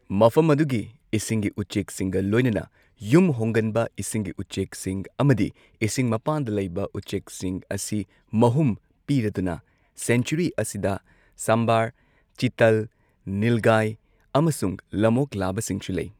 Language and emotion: Manipuri, neutral